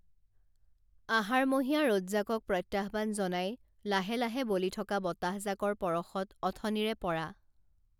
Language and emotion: Assamese, neutral